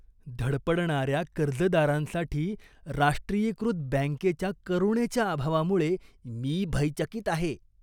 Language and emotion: Marathi, disgusted